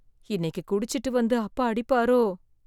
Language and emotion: Tamil, fearful